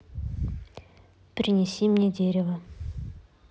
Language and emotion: Russian, neutral